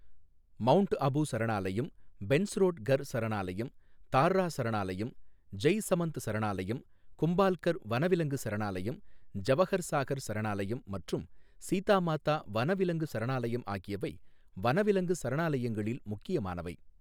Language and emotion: Tamil, neutral